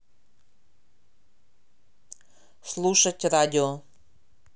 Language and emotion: Russian, neutral